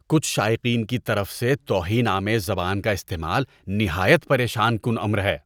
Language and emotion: Urdu, disgusted